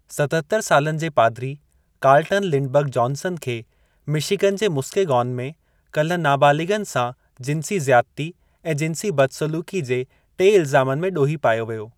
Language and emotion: Sindhi, neutral